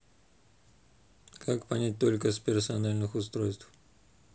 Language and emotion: Russian, neutral